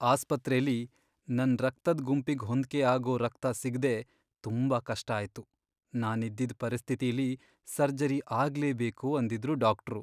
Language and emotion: Kannada, sad